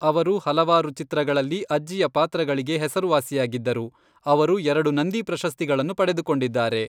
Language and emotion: Kannada, neutral